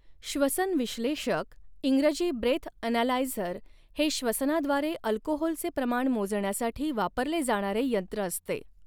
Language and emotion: Marathi, neutral